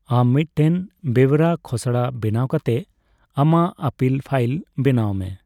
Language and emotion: Santali, neutral